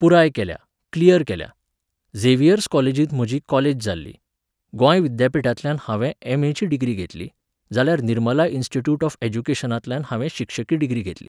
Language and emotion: Goan Konkani, neutral